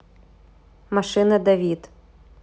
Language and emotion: Russian, neutral